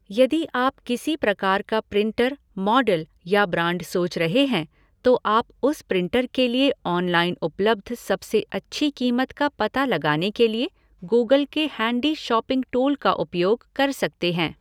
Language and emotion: Hindi, neutral